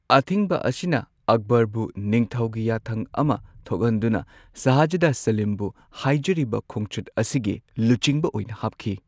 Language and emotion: Manipuri, neutral